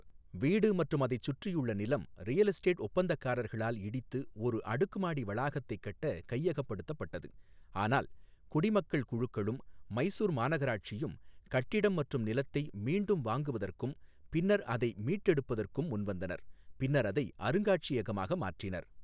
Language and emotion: Tamil, neutral